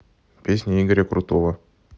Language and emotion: Russian, neutral